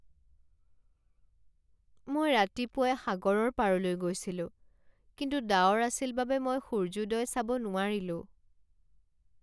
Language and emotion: Assamese, sad